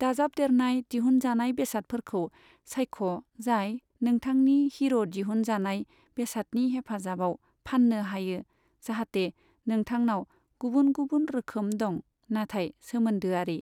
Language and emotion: Bodo, neutral